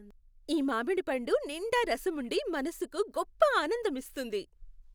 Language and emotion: Telugu, happy